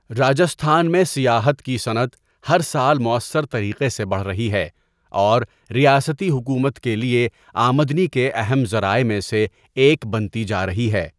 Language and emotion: Urdu, neutral